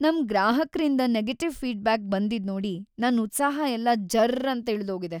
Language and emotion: Kannada, sad